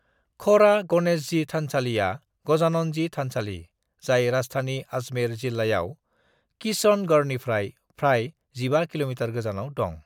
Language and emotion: Bodo, neutral